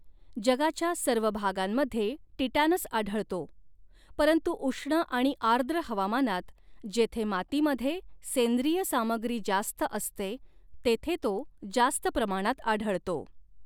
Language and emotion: Marathi, neutral